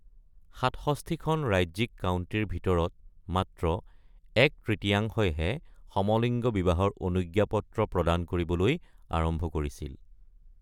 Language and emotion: Assamese, neutral